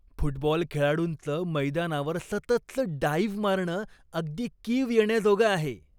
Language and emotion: Marathi, disgusted